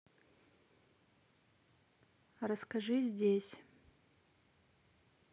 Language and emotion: Russian, neutral